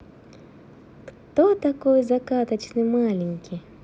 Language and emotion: Russian, positive